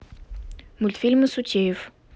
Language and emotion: Russian, neutral